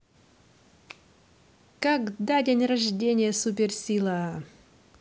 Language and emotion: Russian, positive